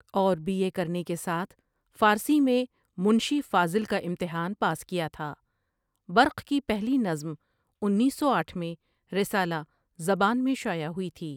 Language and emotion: Urdu, neutral